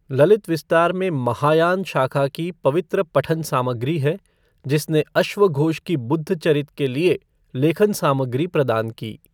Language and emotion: Hindi, neutral